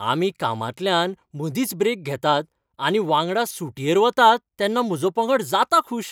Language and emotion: Goan Konkani, happy